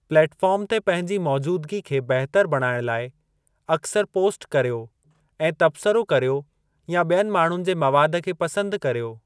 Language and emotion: Sindhi, neutral